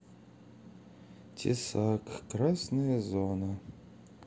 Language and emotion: Russian, sad